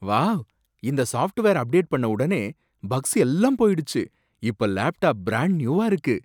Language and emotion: Tamil, surprised